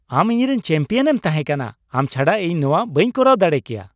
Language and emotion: Santali, happy